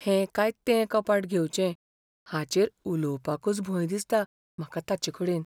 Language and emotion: Goan Konkani, fearful